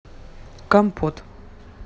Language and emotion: Russian, neutral